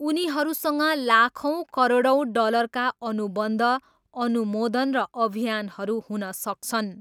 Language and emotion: Nepali, neutral